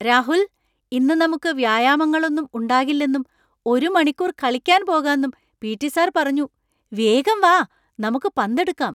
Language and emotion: Malayalam, surprised